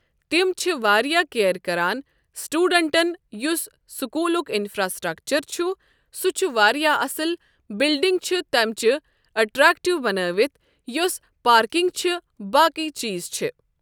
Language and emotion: Kashmiri, neutral